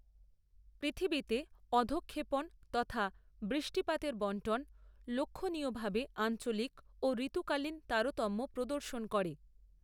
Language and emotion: Bengali, neutral